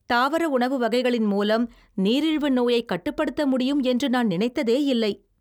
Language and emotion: Tamil, surprised